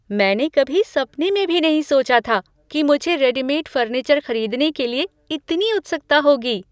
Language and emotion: Hindi, surprised